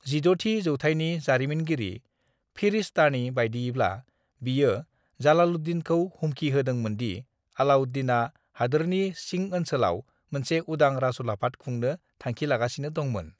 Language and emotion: Bodo, neutral